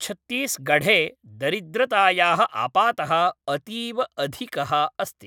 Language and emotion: Sanskrit, neutral